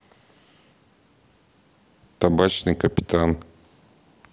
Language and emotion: Russian, neutral